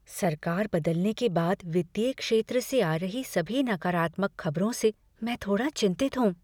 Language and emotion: Hindi, fearful